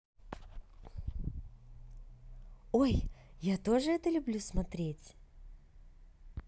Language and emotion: Russian, positive